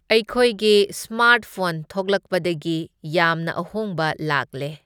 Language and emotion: Manipuri, neutral